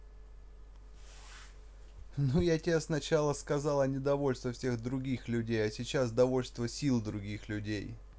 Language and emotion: Russian, neutral